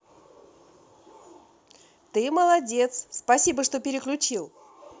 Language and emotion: Russian, positive